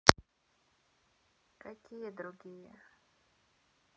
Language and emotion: Russian, neutral